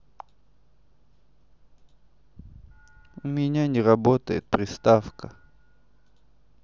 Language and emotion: Russian, sad